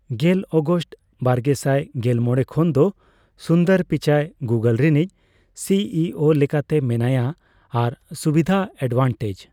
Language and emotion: Santali, neutral